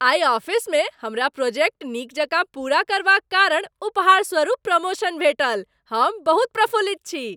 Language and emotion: Maithili, happy